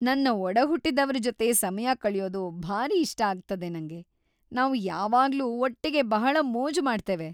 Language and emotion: Kannada, happy